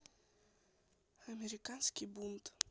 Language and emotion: Russian, neutral